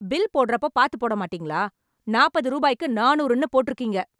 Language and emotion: Tamil, angry